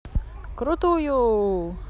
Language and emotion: Russian, positive